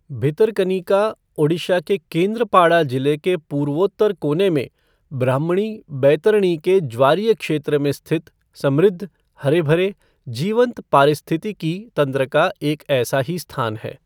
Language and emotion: Hindi, neutral